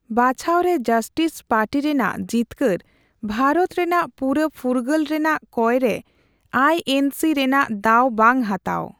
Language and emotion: Santali, neutral